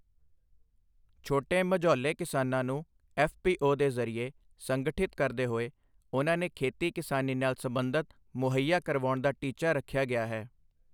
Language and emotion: Punjabi, neutral